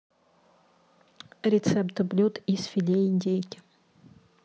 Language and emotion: Russian, neutral